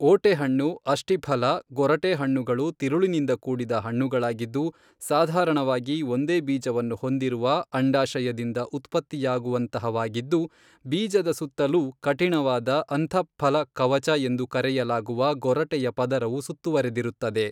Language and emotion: Kannada, neutral